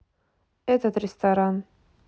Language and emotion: Russian, neutral